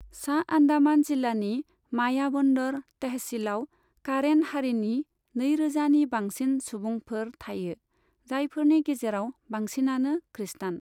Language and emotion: Bodo, neutral